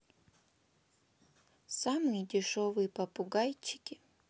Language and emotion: Russian, sad